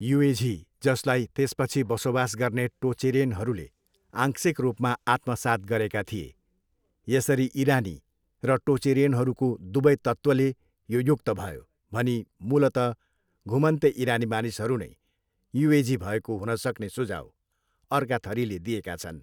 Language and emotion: Nepali, neutral